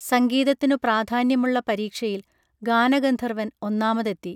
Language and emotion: Malayalam, neutral